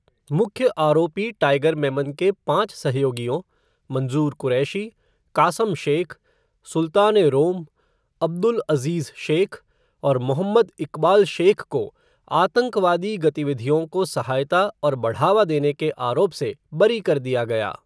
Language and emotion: Hindi, neutral